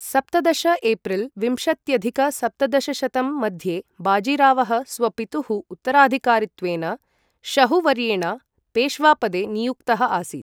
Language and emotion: Sanskrit, neutral